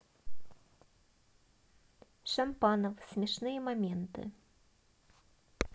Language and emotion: Russian, neutral